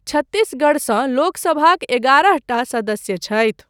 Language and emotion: Maithili, neutral